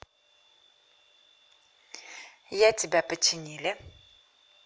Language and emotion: Russian, positive